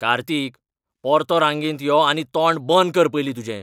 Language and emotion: Goan Konkani, angry